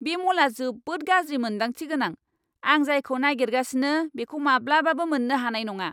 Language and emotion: Bodo, angry